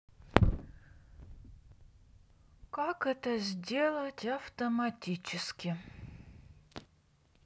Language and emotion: Russian, sad